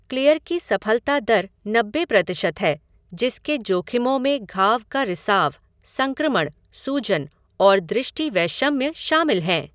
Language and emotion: Hindi, neutral